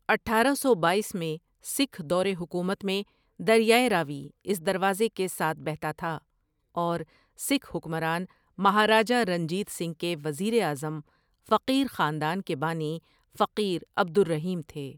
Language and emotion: Urdu, neutral